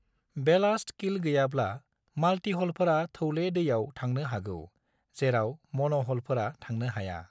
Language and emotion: Bodo, neutral